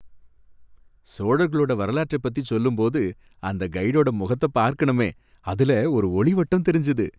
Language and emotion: Tamil, happy